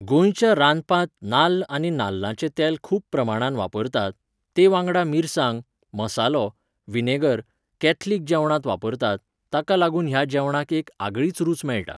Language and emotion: Goan Konkani, neutral